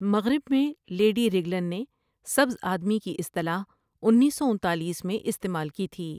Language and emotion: Urdu, neutral